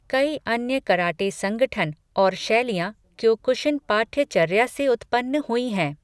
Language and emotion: Hindi, neutral